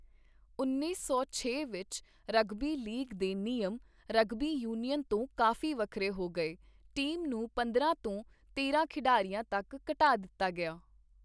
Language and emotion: Punjabi, neutral